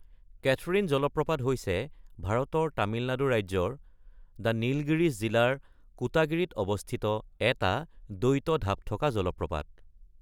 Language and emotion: Assamese, neutral